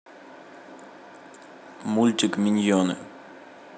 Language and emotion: Russian, neutral